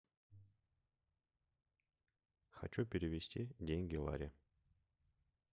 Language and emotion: Russian, neutral